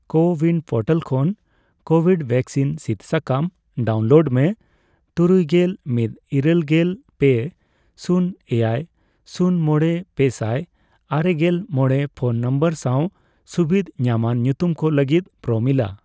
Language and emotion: Santali, neutral